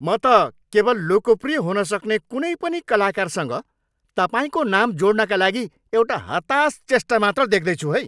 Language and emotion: Nepali, angry